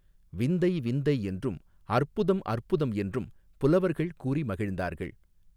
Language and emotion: Tamil, neutral